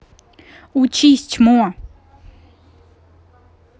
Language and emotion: Russian, angry